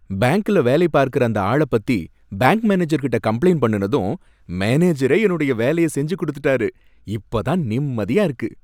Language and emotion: Tamil, happy